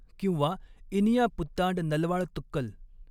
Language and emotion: Marathi, neutral